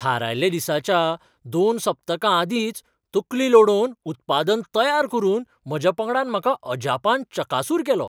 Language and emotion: Goan Konkani, surprised